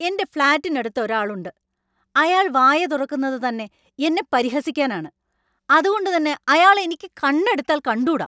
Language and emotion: Malayalam, angry